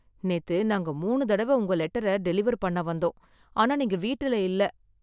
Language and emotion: Tamil, sad